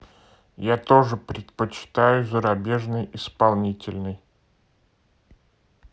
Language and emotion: Russian, neutral